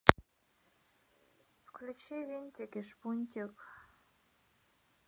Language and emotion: Russian, sad